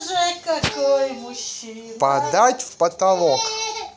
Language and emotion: Russian, positive